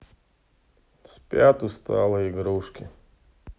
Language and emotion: Russian, sad